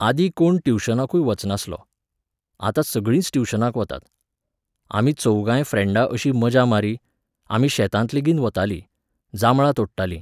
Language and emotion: Goan Konkani, neutral